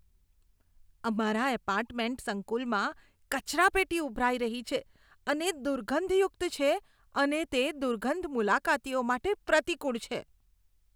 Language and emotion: Gujarati, disgusted